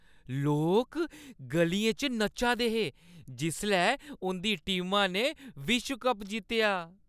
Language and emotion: Dogri, happy